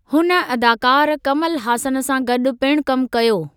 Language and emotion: Sindhi, neutral